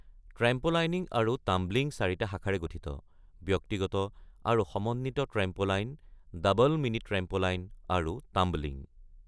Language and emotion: Assamese, neutral